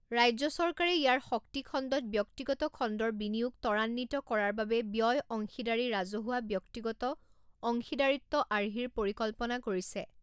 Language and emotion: Assamese, neutral